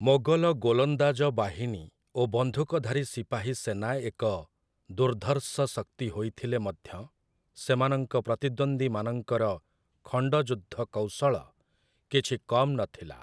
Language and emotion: Odia, neutral